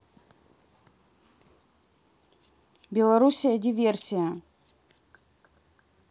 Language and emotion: Russian, neutral